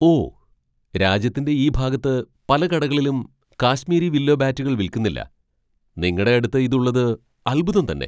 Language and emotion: Malayalam, surprised